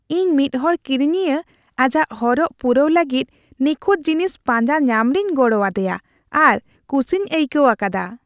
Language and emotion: Santali, happy